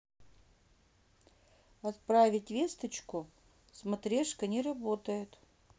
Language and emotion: Russian, neutral